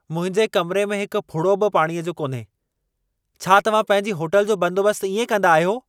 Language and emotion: Sindhi, angry